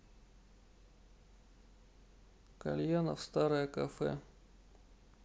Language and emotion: Russian, sad